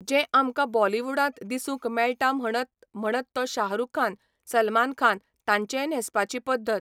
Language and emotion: Goan Konkani, neutral